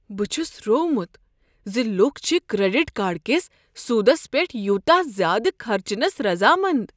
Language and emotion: Kashmiri, surprised